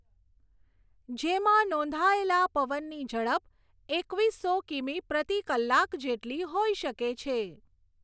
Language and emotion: Gujarati, neutral